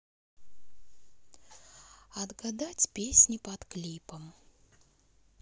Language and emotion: Russian, neutral